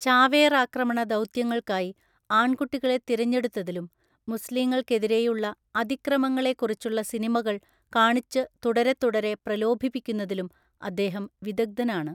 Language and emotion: Malayalam, neutral